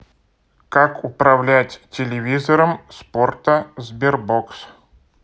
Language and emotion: Russian, neutral